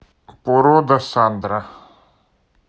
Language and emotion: Russian, neutral